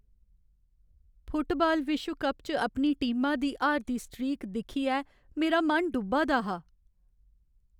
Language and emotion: Dogri, sad